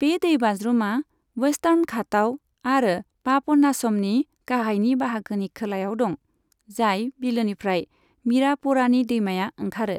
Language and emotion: Bodo, neutral